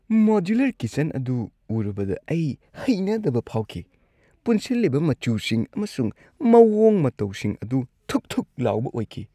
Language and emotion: Manipuri, disgusted